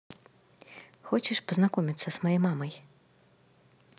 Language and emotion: Russian, positive